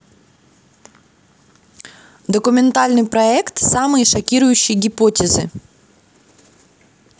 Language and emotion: Russian, positive